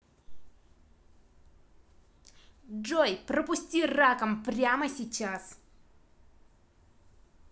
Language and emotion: Russian, angry